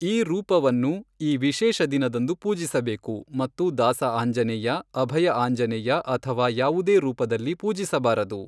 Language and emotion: Kannada, neutral